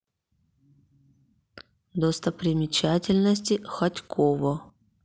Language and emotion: Russian, neutral